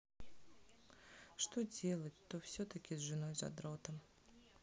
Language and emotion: Russian, sad